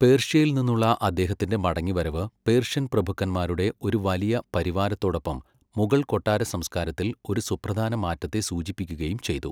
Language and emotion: Malayalam, neutral